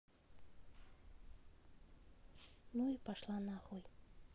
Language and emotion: Russian, neutral